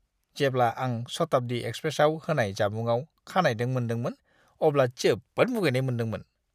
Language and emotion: Bodo, disgusted